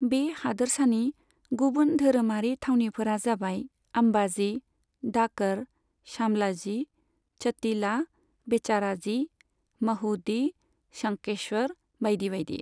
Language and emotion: Bodo, neutral